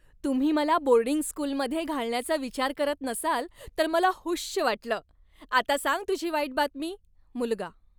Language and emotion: Marathi, happy